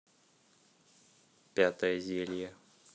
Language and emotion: Russian, neutral